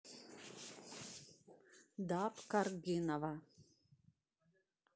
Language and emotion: Russian, neutral